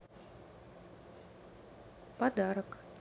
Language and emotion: Russian, neutral